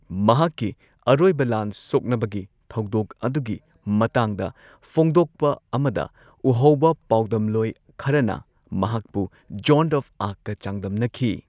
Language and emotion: Manipuri, neutral